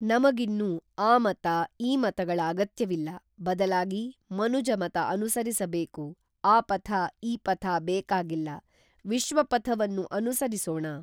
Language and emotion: Kannada, neutral